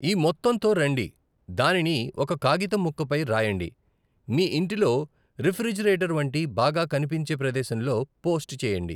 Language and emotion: Telugu, neutral